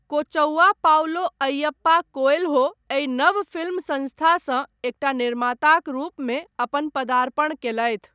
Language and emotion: Maithili, neutral